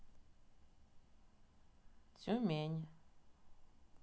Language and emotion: Russian, neutral